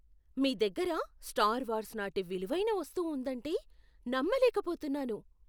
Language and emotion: Telugu, surprised